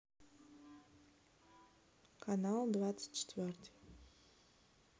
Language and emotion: Russian, neutral